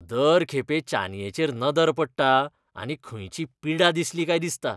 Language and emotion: Goan Konkani, disgusted